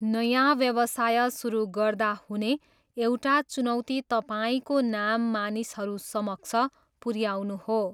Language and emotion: Nepali, neutral